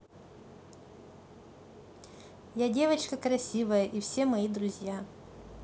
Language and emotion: Russian, positive